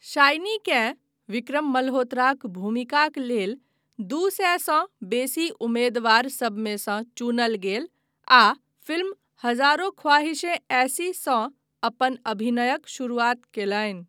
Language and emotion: Maithili, neutral